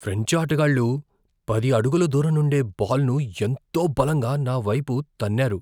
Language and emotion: Telugu, fearful